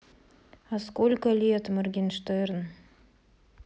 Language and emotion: Russian, sad